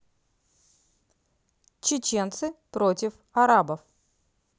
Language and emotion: Russian, neutral